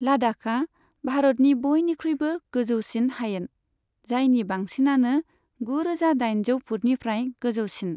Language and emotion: Bodo, neutral